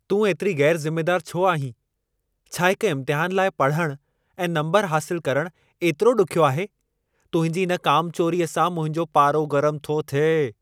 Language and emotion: Sindhi, angry